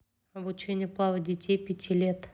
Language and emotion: Russian, neutral